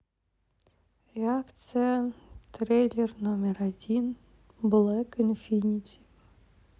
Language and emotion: Russian, sad